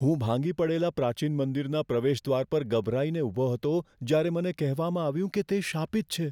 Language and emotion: Gujarati, fearful